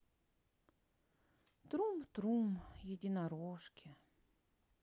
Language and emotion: Russian, sad